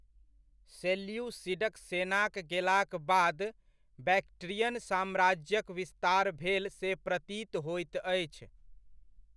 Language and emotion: Maithili, neutral